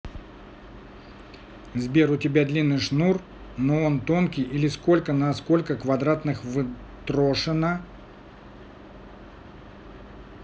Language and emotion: Russian, neutral